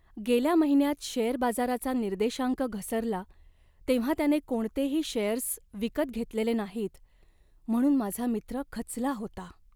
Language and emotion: Marathi, sad